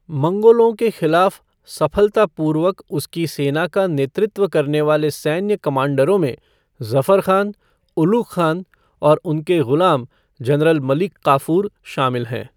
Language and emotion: Hindi, neutral